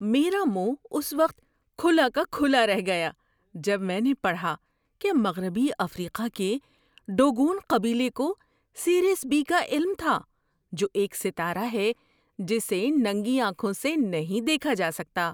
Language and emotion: Urdu, surprised